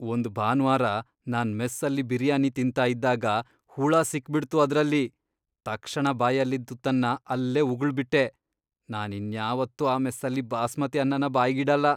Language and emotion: Kannada, disgusted